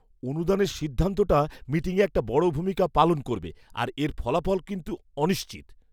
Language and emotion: Bengali, fearful